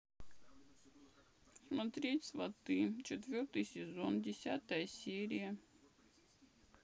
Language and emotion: Russian, sad